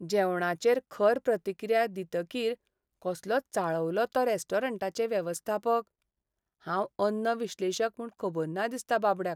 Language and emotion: Goan Konkani, sad